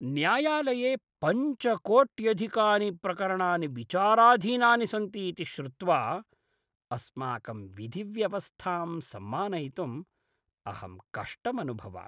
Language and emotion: Sanskrit, disgusted